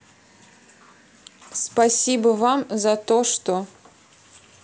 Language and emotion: Russian, neutral